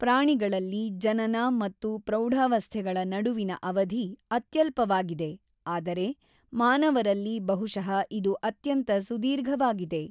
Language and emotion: Kannada, neutral